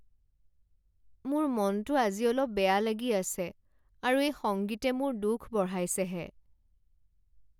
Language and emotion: Assamese, sad